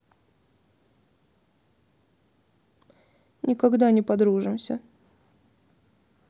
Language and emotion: Russian, sad